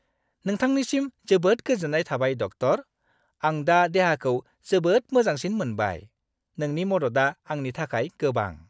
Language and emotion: Bodo, happy